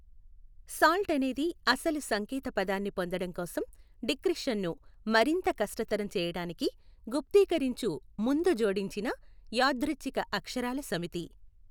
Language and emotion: Telugu, neutral